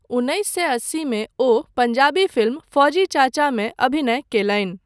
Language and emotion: Maithili, neutral